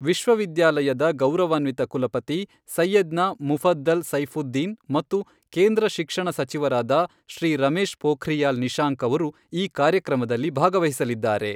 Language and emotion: Kannada, neutral